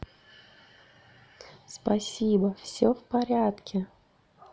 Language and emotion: Russian, positive